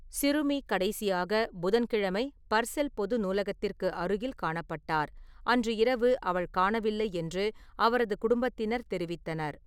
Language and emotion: Tamil, neutral